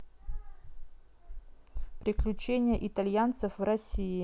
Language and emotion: Russian, neutral